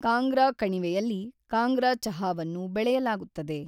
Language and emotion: Kannada, neutral